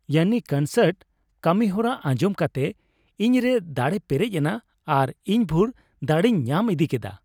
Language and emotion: Santali, happy